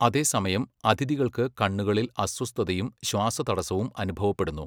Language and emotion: Malayalam, neutral